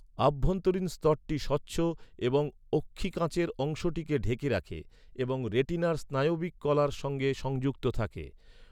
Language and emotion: Bengali, neutral